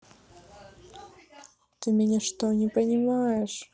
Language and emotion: Russian, sad